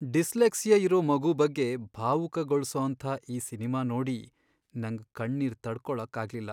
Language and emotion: Kannada, sad